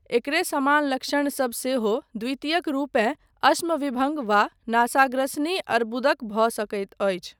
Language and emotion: Maithili, neutral